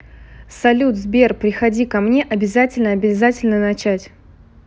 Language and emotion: Russian, positive